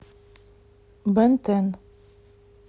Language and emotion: Russian, neutral